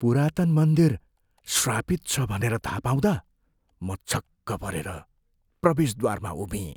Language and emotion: Nepali, fearful